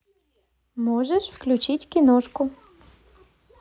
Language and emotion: Russian, positive